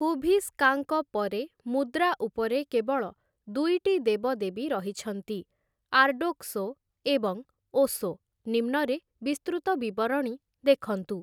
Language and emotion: Odia, neutral